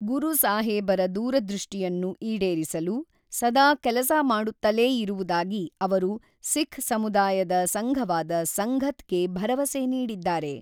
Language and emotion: Kannada, neutral